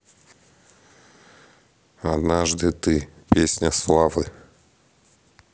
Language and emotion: Russian, neutral